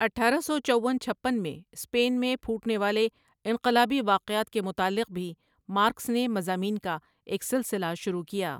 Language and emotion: Urdu, neutral